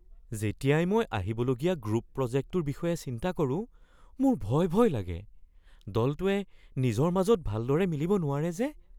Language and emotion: Assamese, fearful